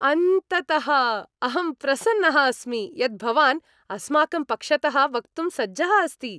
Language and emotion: Sanskrit, happy